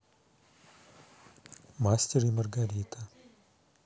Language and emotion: Russian, neutral